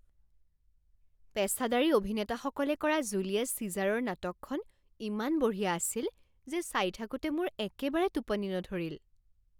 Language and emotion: Assamese, happy